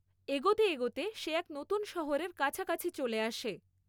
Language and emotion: Bengali, neutral